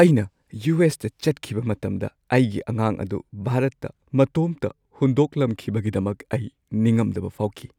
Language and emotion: Manipuri, sad